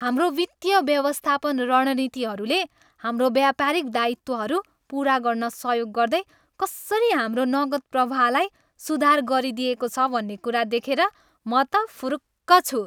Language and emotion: Nepali, happy